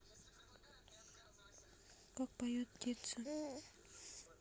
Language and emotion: Russian, neutral